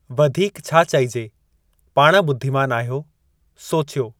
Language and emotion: Sindhi, neutral